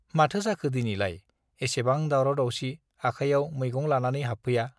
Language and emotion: Bodo, neutral